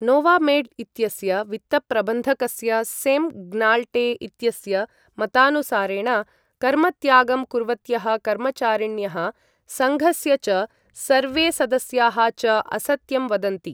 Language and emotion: Sanskrit, neutral